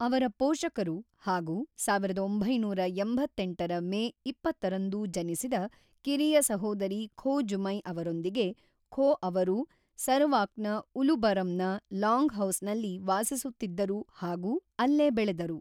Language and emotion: Kannada, neutral